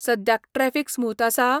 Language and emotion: Goan Konkani, neutral